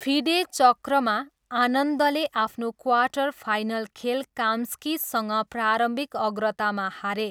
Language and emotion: Nepali, neutral